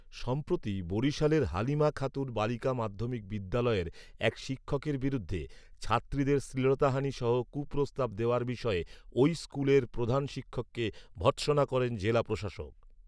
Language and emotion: Bengali, neutral